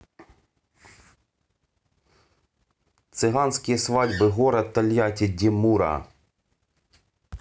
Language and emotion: Russian, neutral